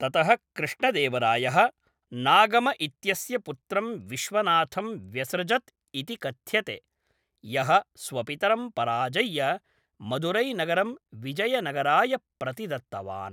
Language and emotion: Sanskrit, neutral